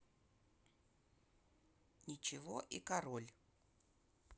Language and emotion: Russian, neutral